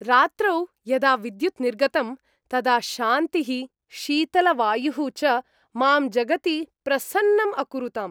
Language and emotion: Sanskrit, happy